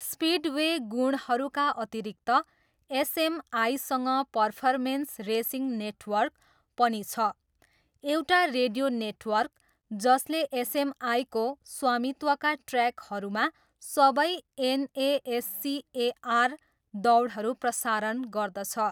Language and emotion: Nepali, neutral